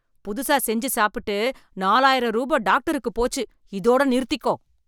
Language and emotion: Tamil, angry